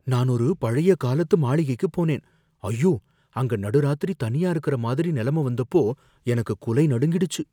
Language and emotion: Tamil, fearful